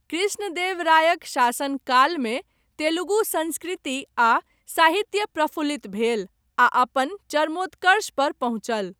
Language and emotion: Maithili, neutral